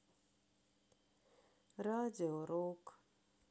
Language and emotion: Russian, sad